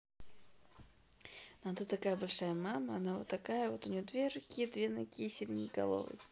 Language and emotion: Russian, positive